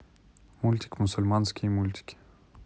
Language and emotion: Russian, neutral